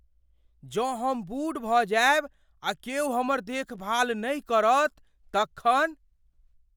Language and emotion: Maithili, fearful